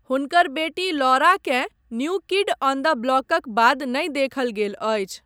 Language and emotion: Maithili, neutral